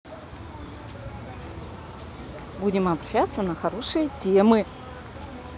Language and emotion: Russian, positive